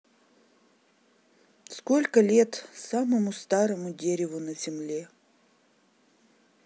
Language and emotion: Russian, sad